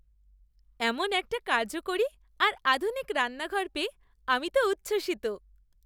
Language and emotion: Bengali, happy